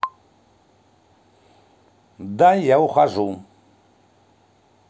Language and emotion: Russian, angry